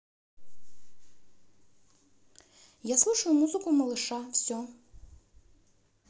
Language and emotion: Russian, neutral